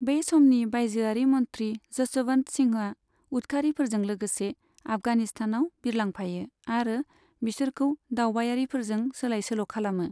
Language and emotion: Bodo, neutral